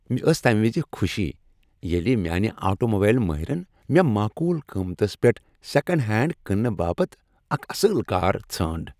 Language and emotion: Kashmiri, happy